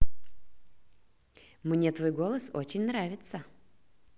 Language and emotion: Russian, positive